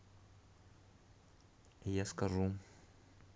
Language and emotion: Russian, neutral